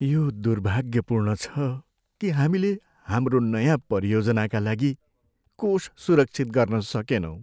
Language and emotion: Nepali, sad